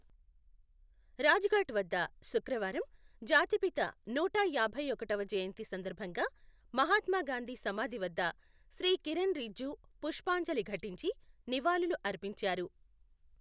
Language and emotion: Telugu, neutral